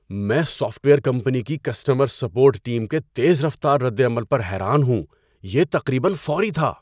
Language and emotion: Urdu, surprised